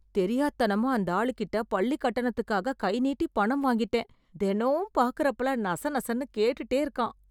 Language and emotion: Tamil, disgusted